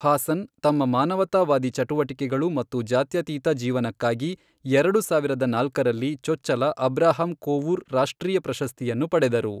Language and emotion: Kannada, neutral